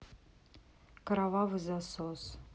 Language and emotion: Russian, neutral